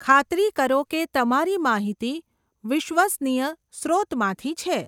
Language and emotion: Gujarati, neutral